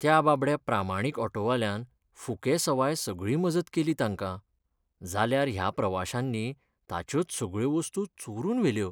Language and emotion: Goan Konkani, sad